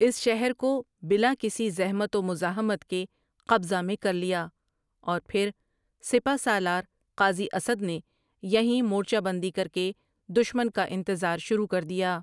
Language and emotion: Urdu, neutral